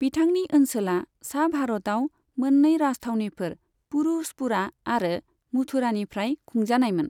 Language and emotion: Bodo, neutral